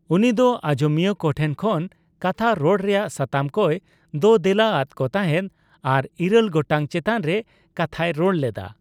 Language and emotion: Santali, neutral